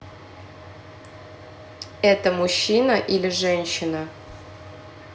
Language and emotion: Russian, neutral